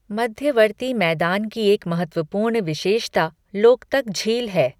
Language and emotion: Hindi, neutral